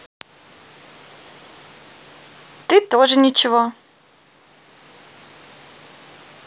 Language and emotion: Russian, positive